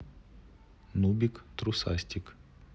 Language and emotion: Russian, neutral